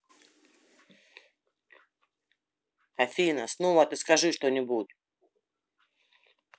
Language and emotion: Russian, angry